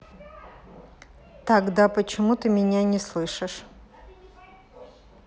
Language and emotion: Russian, neutral